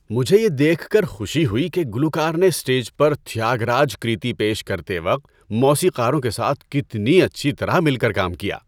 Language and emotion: Urdu, happy